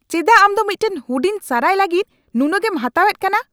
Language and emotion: Santali, angry